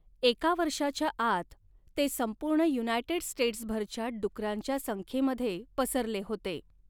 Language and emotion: Marathi, neutral